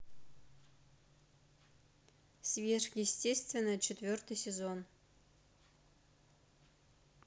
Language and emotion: Russian, neutral